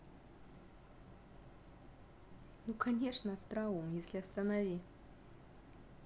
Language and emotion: Russian, positive